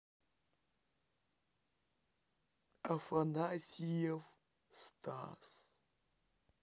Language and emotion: Russian, sad